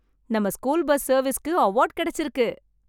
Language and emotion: Tamil, happy